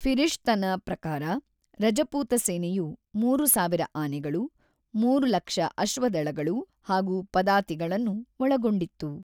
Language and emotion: Kannada, neutral